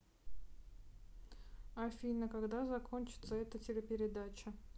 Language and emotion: Russian, neutral